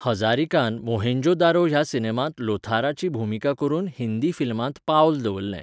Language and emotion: Goan Konkani, neutral